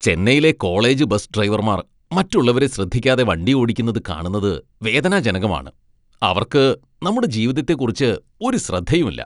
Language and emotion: Malayalam, disgusted